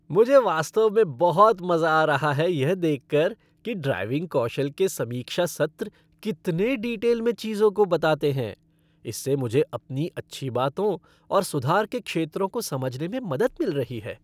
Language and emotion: Hindi, happy